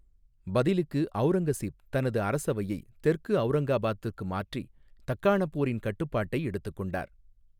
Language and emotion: Tamil, neutral